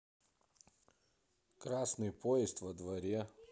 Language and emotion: Russian, neutral